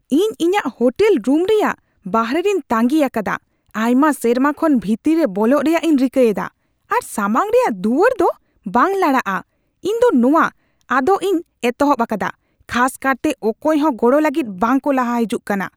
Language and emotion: Santali, angry